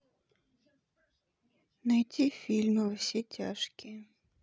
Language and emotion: Russian, sad